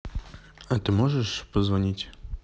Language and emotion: Russian, neutral